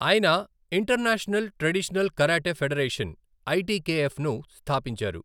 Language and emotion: Telugu, neutral